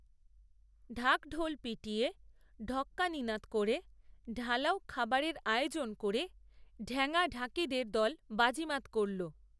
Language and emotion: Bengali, neutral